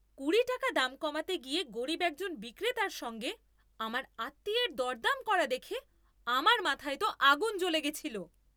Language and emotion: Bengali, angry